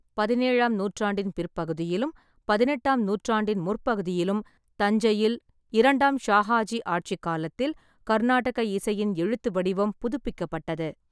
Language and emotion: Tamil, neutral